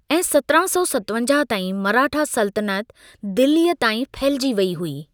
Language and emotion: Sindhi, neutral